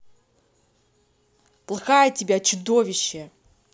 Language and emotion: Russian, angry